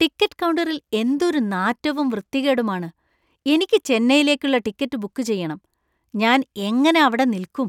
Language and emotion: Malayalam, disgusted